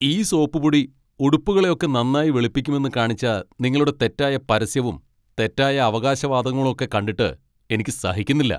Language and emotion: Malayalam, angry